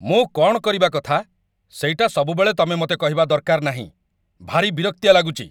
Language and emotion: Odia, angry